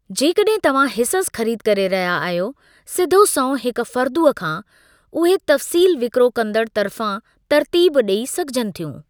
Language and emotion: Sindhi, neutral